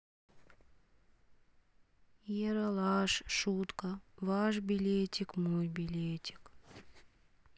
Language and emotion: Russian, sad